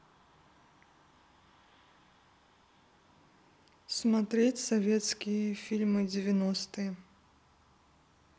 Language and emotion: Russian, neutral